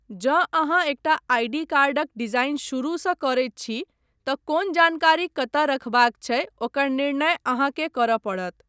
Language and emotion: Maithili, neutral